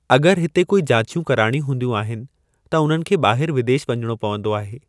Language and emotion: Sindhi, neutral